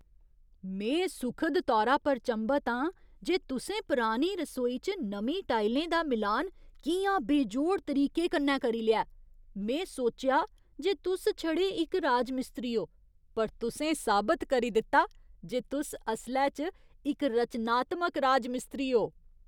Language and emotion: Dogri, surprised